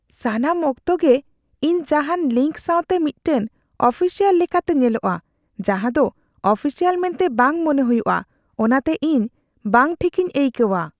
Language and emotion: Santali, fearful